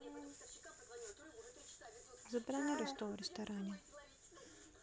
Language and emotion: Russian, neutral